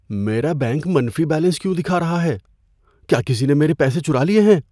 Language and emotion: Urdu, fearful